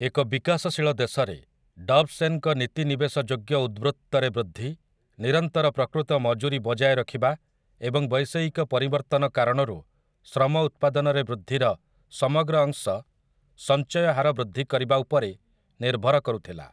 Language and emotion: Odia, neutral